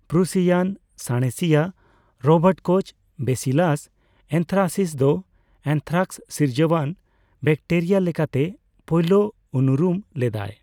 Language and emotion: Santali, neutral